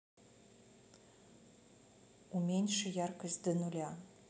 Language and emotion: Russian, neutral